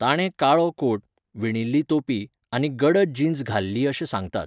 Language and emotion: Goan Konkani, neutral